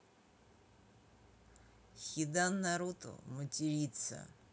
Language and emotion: Russian, neutral